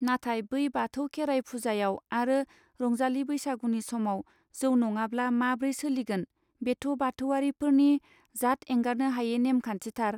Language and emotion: Bodo, neutral